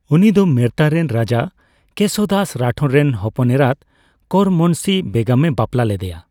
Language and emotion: Santali, neutral